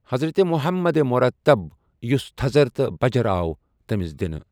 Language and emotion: Kashmiri, neutral